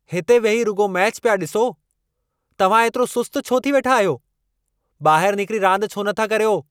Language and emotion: Sindhi, angry